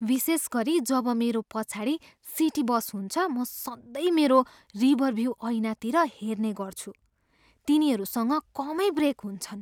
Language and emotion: Nepali, fearful